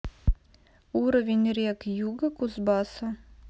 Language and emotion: Russian, neutral